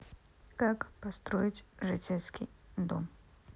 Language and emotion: Russian, neutral